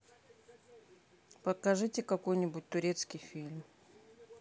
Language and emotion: Russian, neutral